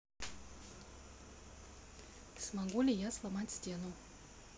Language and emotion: Russian, neutral